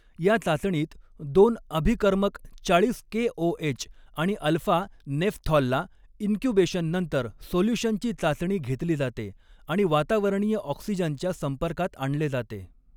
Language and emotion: Marathi, neutral